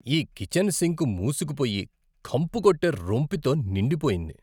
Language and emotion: Telugu, disgusted